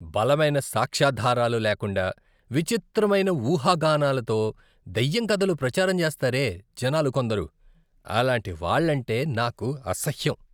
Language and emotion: Telugu, disgusted